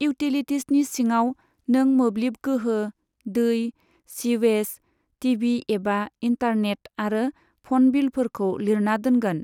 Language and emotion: Bodo, neutral